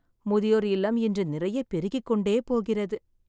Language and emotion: Tamil, sad